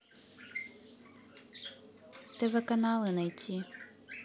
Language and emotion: Russian, neutral